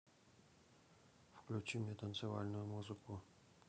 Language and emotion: Russian, neutral